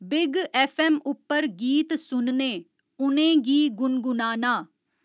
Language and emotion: Dogri, neutral